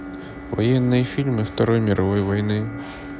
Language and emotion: Russian, neutral